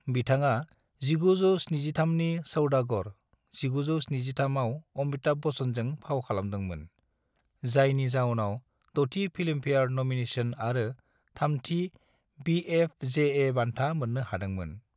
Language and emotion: Bodo, neutral